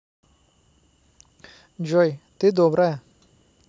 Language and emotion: Russian, neutral